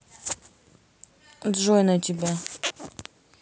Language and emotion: Russian, neutral